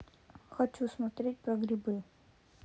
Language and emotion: Russian, neutral